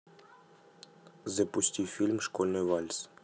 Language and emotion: Russian, neutral